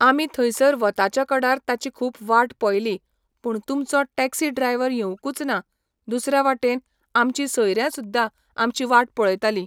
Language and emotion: Goan Konkani, neutral